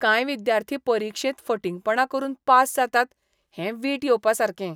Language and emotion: Goan Konkani, disgusted